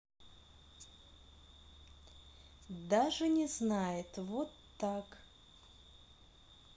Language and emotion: Russian, neutral